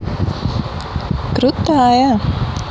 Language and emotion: Russian, positive